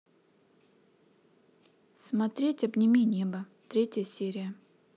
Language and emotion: Russian, neutral